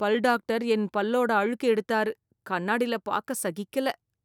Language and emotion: Tamil, disgusted